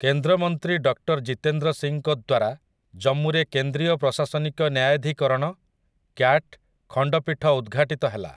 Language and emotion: Odia, neutral